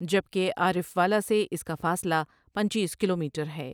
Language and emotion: Urdu, neutral